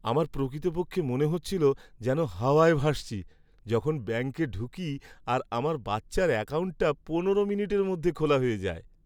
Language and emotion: Bengali, happy